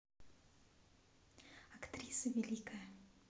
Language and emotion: Russian, neutral